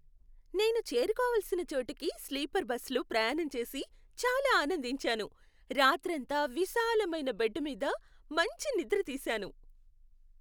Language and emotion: Telugu, happy